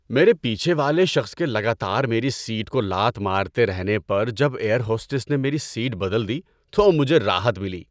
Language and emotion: Urdu, happy